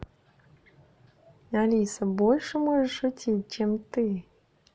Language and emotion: Russian, positive